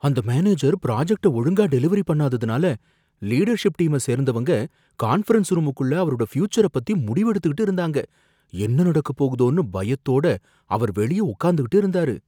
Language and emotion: Tamil, fearful